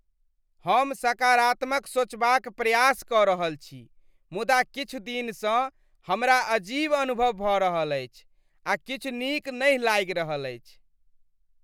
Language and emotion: Maithili, disgusted